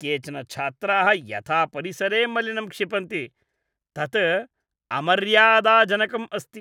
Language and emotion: Sanskrit, disgusted